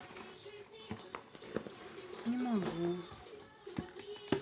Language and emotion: Russian, sad